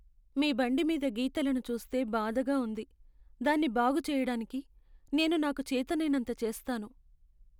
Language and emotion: Telugu, sad